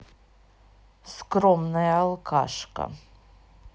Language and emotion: Russian, neutral